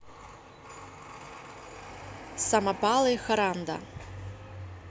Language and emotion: Russian, neutral